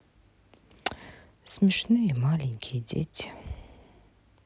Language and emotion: Russian, sad